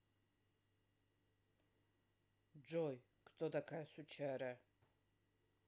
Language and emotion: Russian, neutral